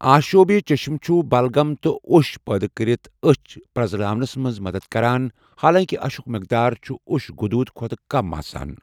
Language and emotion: Kashmiri, neutral